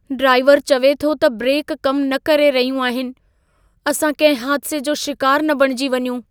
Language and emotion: Sindhi, fearful